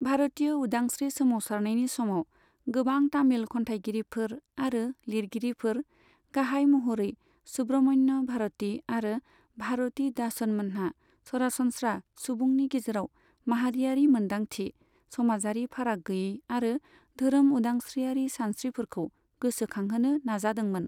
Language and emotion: Bodo, neutral